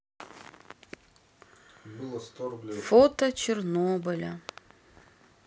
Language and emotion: Russian, sad